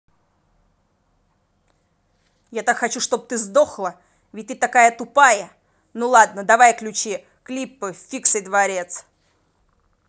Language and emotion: Russian, angry